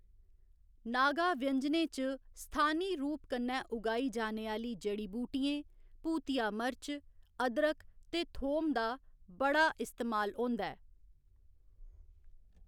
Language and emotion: Dogri, neutral